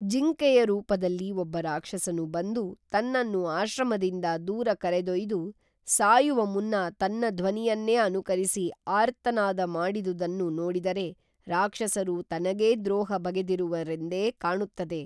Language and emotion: Kannada, neutral